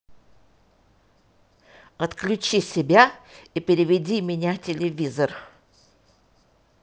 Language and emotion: Russian, angry